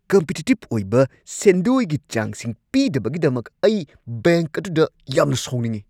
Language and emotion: Manipuri, angry